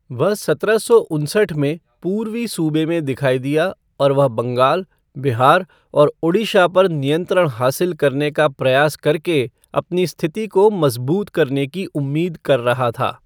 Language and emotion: Hindi, neutral